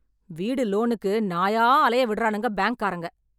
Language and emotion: Tamil, angry